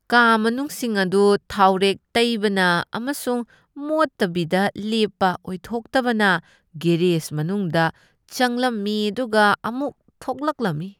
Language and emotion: Manipuri, disgusted